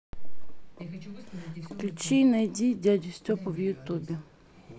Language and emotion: Russian, neutral